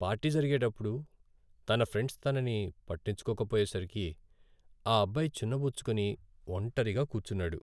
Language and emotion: Telugu, sad